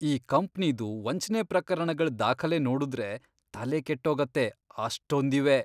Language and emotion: Kannada, disgusted